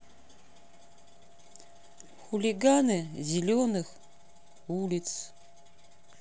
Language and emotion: Russian, neutral